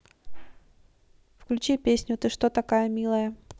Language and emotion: Russian, neutral